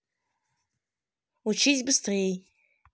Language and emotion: Russian, angry